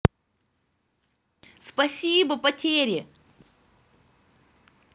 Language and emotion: Russian, positive